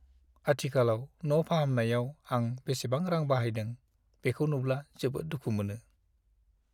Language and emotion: Bodo, sad